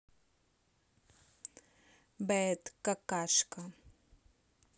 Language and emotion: Russian, neutral